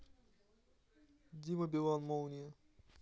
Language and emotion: Russian, neutral